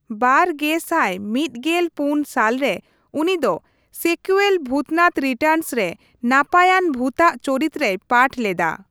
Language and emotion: Santali, neutral